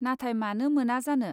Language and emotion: Bodo, neutral